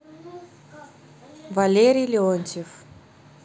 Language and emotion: Russian, neutral